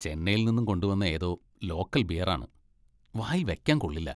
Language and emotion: Malayalam, disgusted